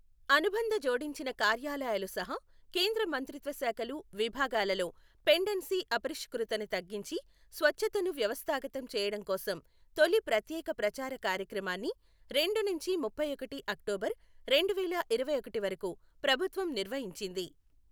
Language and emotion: Telugu, neutral